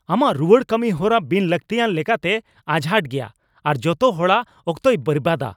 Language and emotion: Santali, angry